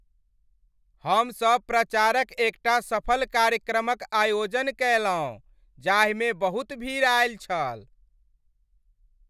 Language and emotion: Maithili, happy